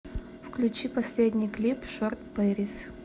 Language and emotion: Russian, neutral